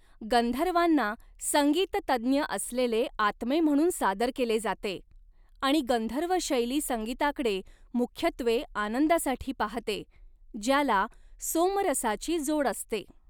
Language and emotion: Marathi, neutral